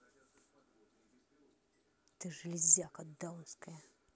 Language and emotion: Russian, angry